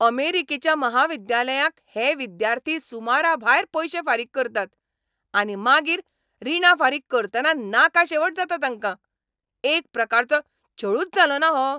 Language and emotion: Goan Konkani, angry